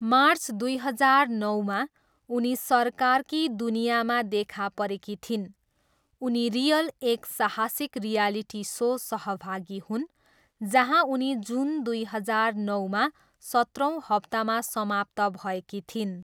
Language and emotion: Nepali, neutral